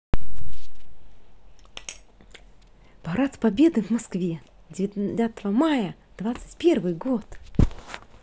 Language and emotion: Russian, positive